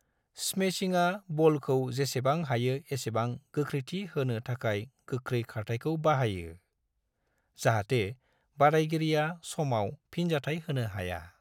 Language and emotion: Bodo, neutral